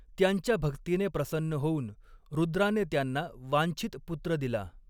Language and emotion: Marathi, neutral